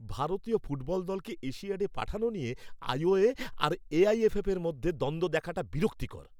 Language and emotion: Bengali, angry